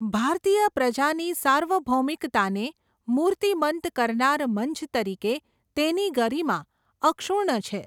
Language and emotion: Gujarati, neutral